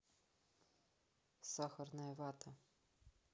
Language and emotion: Russian, neutral